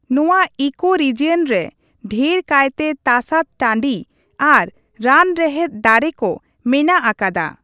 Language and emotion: Santali, neutral